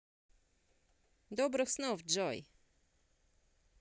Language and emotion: Russian, positive